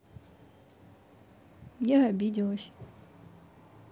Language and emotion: Russian, sad